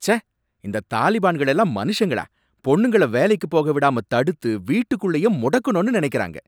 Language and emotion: Tamil, angry